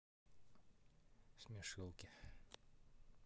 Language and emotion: Russian, neutral